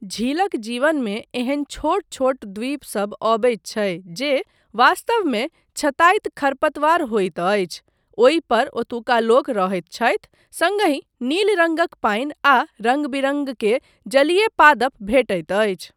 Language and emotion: Maithili, neutral